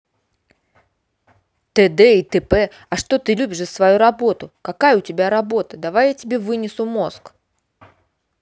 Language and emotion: Russian, angry